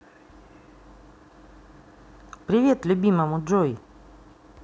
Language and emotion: Russian, neutral